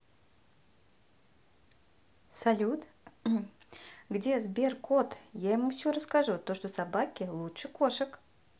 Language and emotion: Russian, positive